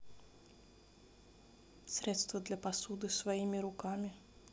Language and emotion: Russian, neutral